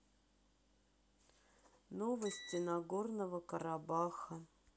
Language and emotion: Russian, sad